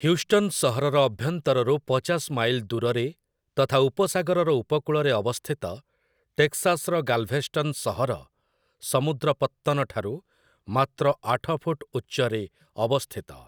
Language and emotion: Odia, neutral